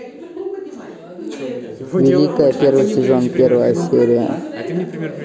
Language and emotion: Russian, neutral